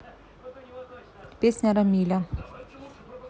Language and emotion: Russian, neutral